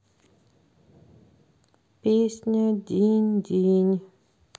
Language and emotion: Russian, neutral